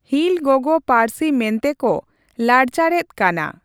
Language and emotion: Santali, neutral